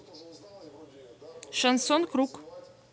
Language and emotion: Russian, neutral